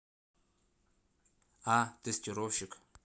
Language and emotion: Russian, neutral